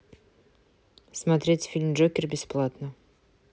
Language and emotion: Russian, neutral